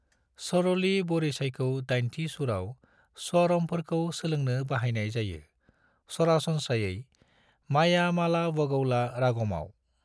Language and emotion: Bodo, neutral